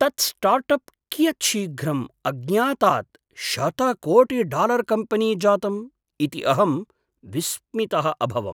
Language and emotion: Sanskrit, surprised